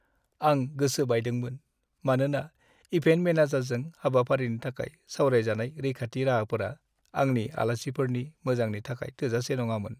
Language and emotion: Bodo, sad